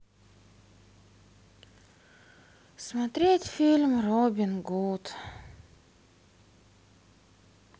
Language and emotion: Russian, sad